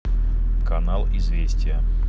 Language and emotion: Russian, neutral